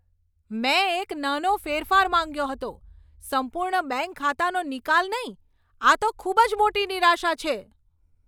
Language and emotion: Gujarati, angry